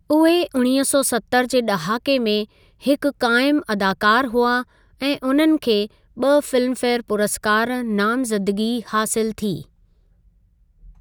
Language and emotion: Sindhi, neutral